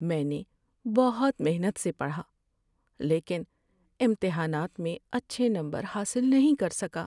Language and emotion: Urdu, sad